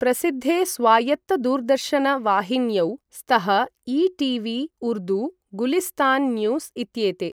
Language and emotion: Sanskrit, neutral